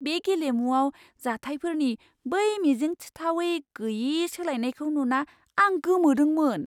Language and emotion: Bodo, surprised